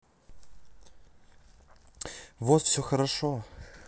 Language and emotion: Russian, neutral